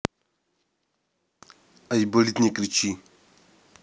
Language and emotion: Russian, neutral